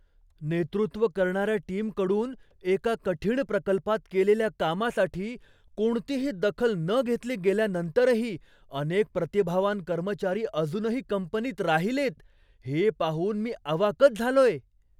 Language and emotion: Marathi, surprised